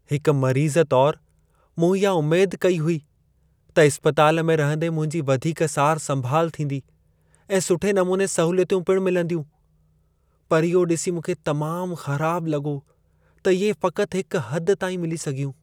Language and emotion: Sindhi, sad